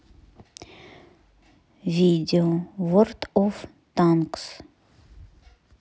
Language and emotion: Russian, neutral